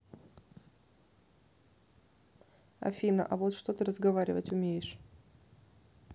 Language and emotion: Russian, neutral